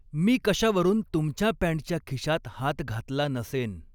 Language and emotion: Marathi, neutral